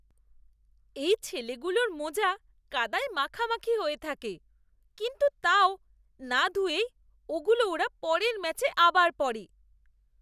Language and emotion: Bengali, disgusted